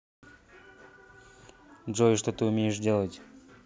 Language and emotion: Russian, neutral